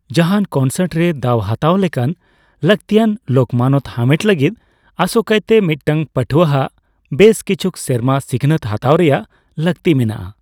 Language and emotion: Santali, neutral